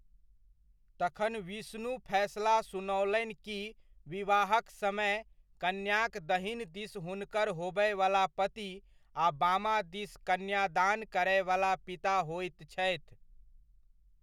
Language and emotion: Maithili, neutral